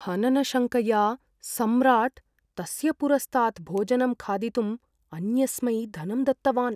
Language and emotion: Sanskrit, fearful